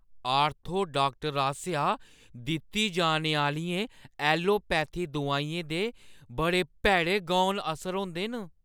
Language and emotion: Dogri, fearful